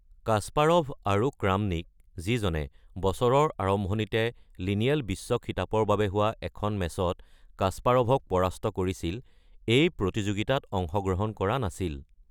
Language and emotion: Assamese, neutral